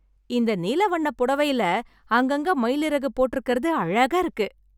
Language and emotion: Tamil, happy